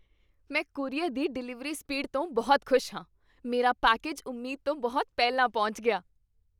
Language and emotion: Punjabi, happy